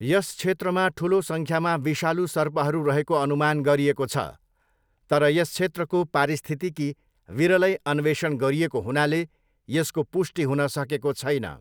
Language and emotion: Nepali, neutral